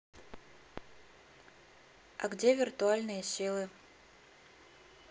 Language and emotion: Russian, neutral